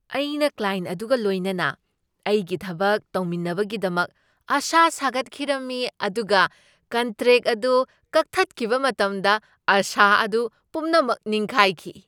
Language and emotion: Manipuri, surprised